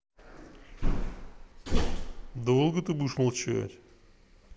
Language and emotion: Russian, angry